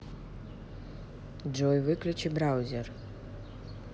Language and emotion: Russian, neutral